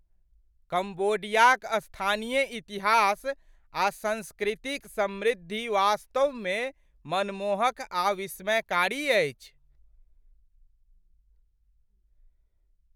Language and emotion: Maithili, surprised